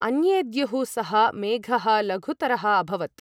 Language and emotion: Sanskrit, neutral